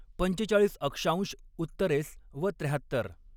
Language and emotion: Marathi, neutral